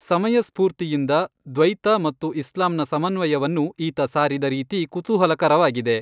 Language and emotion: Kannada, neutral